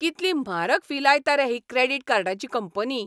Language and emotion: Goan Konkani, angry